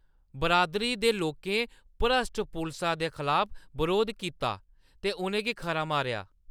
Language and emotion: Dogri, angry